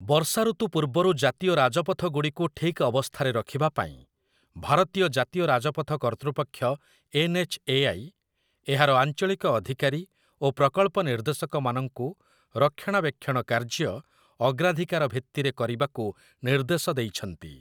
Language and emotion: Odia, neutral